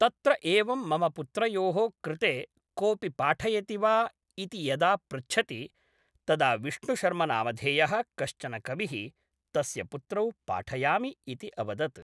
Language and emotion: Sanskrit, neutral